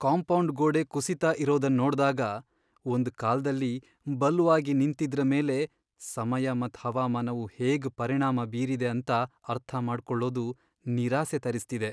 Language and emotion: Kannada, sad